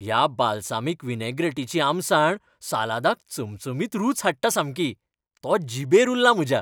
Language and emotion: Goan Konkani, happy